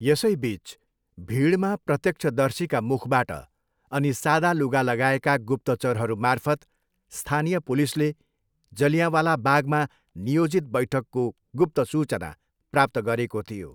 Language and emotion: Nepali, neutral